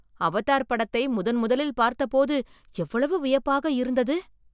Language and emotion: Tamil, surprised